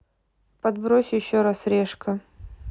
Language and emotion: Russian, neutral